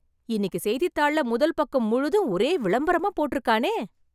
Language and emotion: Tamil, surprised